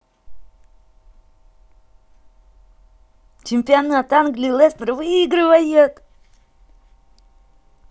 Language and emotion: Russian, positive